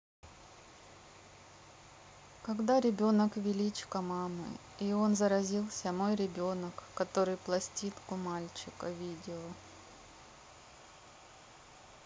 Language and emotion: Russian, neutral